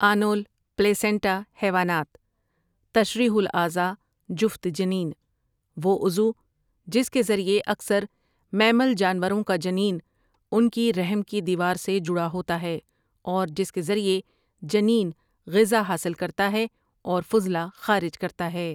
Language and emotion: Urdu, neutral